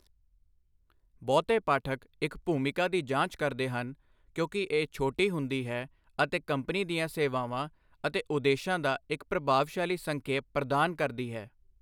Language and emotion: Punjabi, neutral